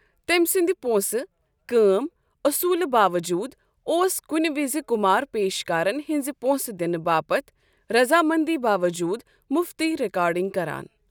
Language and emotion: Kashmiri, neutral